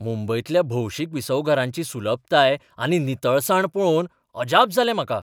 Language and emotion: Goan Konkani, surprised